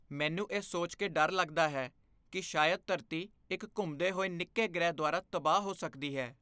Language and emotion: Punjabi, fearful